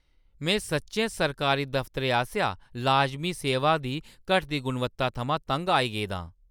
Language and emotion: Dogri, angry